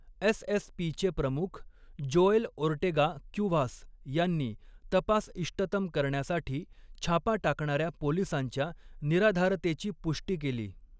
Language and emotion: Marathi, neutral